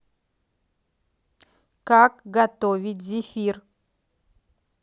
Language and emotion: Russian, neutral